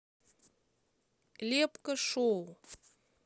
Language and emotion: Russian, neutral